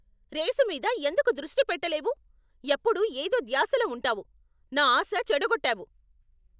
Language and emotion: Telugu, angry